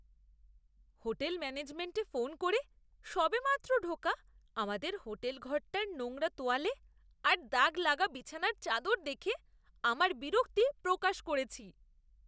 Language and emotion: Bengali, disgusted